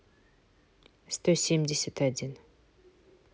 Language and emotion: Russian, neutral